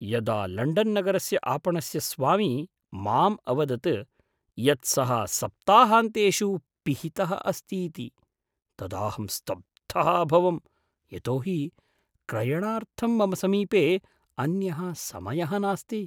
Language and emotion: Sanskrit, surprised